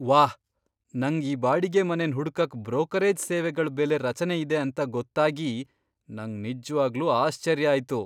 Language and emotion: Kannada, surprised